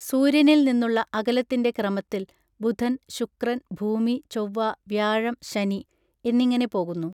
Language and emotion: Malayalam, neutral